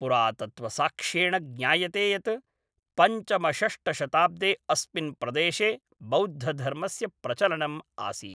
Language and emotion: Sanskrit, neutral